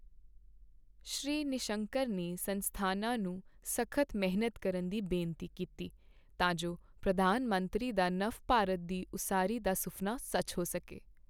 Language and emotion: Punjabi, neutral